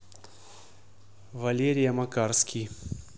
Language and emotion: Russian, neutral